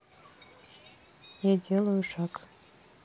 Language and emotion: Russian, neutral